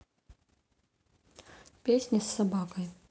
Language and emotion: Russian, neutral